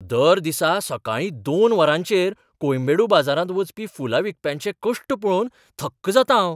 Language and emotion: Goan Konkani, surprised